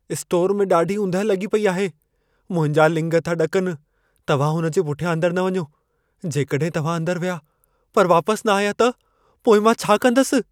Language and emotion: Sindhi, fearful